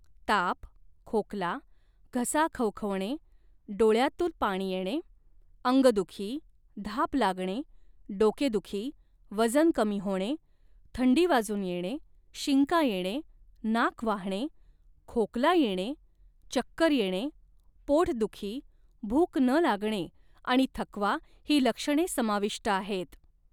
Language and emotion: Marathi, neutral